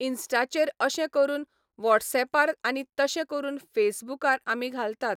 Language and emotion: Goan Konkani, neutral